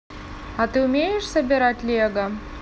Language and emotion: Russian, neutral